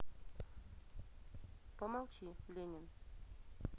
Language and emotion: Russian, neutral